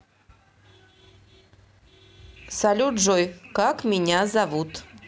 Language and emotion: Russian, neutral